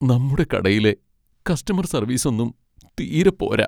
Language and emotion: Malayalam, sad